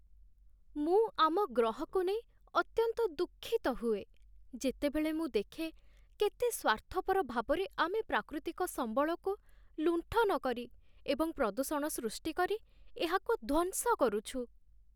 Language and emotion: Odia, sad